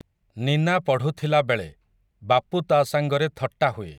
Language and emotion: Odia, neutral